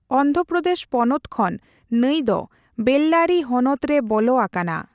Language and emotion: Santali, neutral